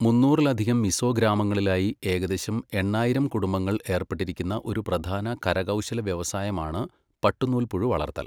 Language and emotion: Malayalam, neutral